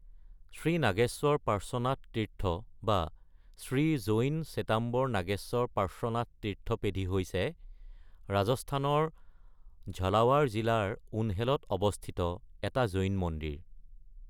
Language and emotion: Assamese, neutral